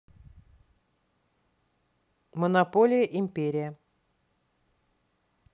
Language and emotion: Russian, neutral